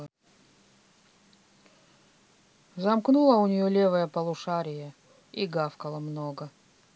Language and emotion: Russian, sad